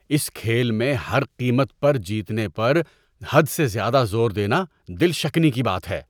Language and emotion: Urdu, disgusted